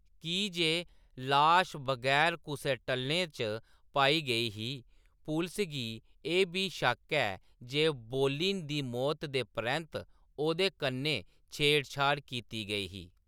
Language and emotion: Dogri, neutral